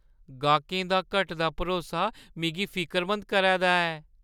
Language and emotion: Dogri, fearful